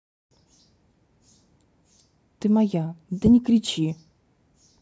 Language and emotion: Russian, neutral